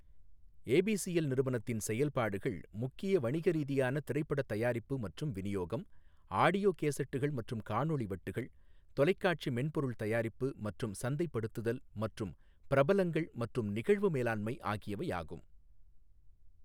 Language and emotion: Tamil, neutral